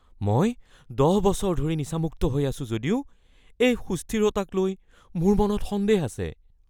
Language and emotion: Assamese, fearful